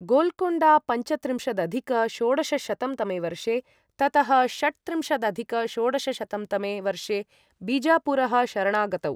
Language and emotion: Sanskrit, neutral